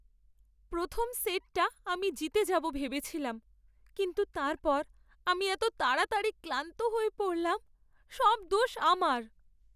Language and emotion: Bengali, sad